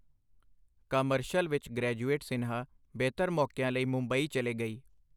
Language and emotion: Punjabi, neutral